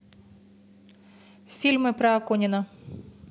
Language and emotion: Russian, neutral